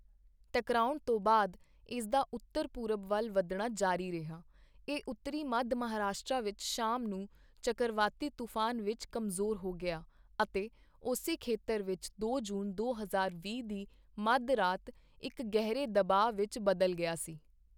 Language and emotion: Punjabi, neutral